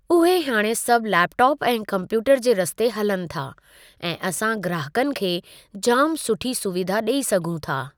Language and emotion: Sindhi, neutral